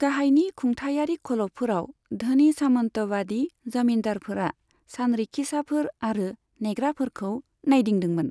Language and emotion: Bodo, neutral